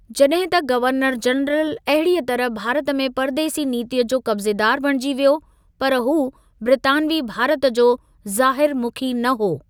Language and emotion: Sindhi, neutral